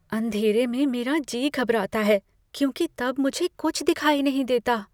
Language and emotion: Hindi, fearful